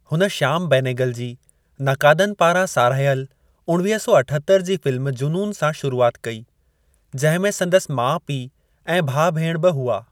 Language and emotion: Sindhi, neutral